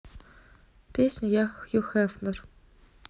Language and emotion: Russian, neutral